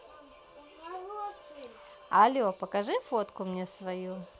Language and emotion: Russian, positive